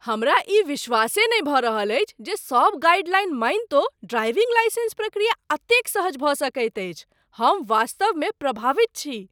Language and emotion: Maithili, surprised